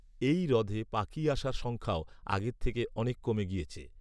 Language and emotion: Bengali, neutral